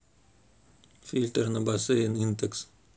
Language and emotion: Russian, neutral